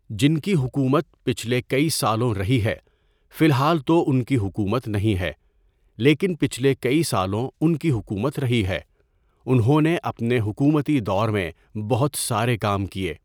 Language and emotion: Urdu, neutral